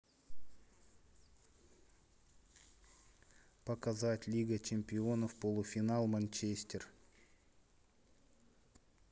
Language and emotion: Russian, neutral